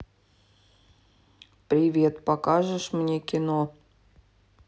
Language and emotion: Russian, sad